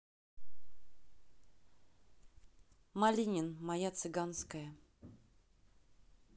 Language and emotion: Russian, neutral